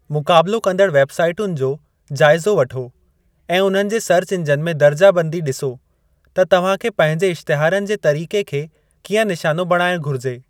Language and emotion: Sindhi, neutral